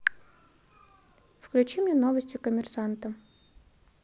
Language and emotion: Russian, neutral